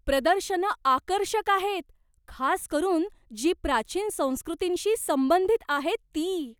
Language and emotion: Marathi, surprised